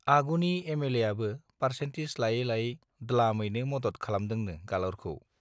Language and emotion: Bodo, neutral